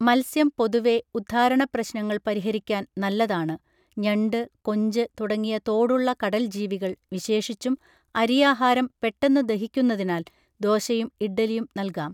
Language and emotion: Malayalam, neutral